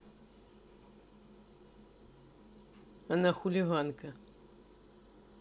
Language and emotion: Russian, neutral